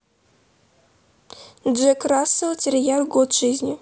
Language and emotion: Russian, neutral